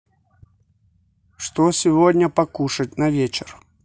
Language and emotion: Russian, neutral